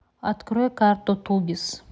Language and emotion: Russian, neutral